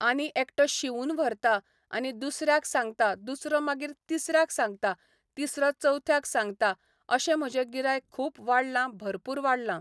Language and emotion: Goan Konkani, neutral